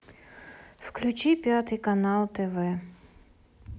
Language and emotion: Russian, sad